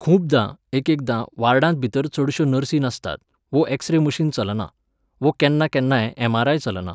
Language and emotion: Goan Konkani, neutral